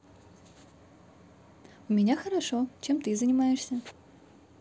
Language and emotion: Russian, positive